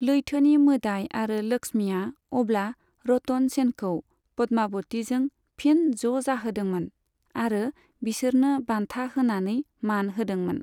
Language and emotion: Bodo, neutral